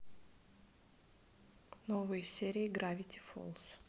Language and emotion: Russian, neutral